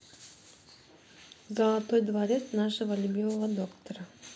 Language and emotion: Russian, neutral